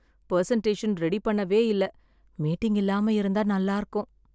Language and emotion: Tamil, sad